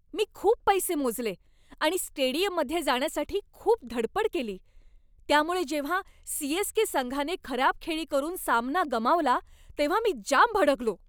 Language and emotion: Marathi, angry